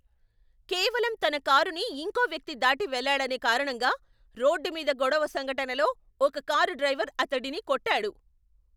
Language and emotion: Telugu, angry